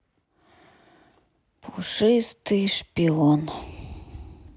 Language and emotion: Russian, sad